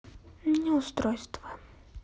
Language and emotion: Russian, sad